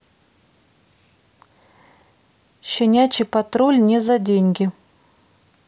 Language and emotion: Russian, neutral